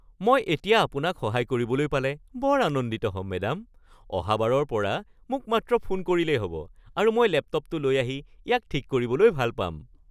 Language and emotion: Assamese, happy